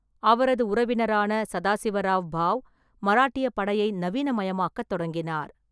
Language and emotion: Tamil, neutral